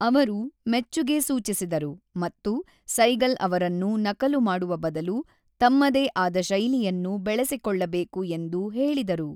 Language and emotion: Kannada, neutral